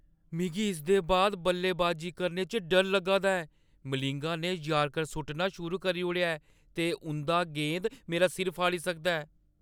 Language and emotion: Dogri, fearful